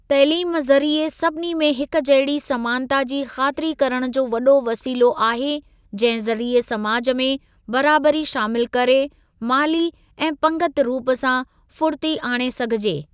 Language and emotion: Sindhi, neutral